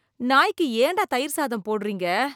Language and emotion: Tamil, disgusted